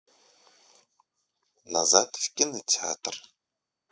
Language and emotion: Russian, neutral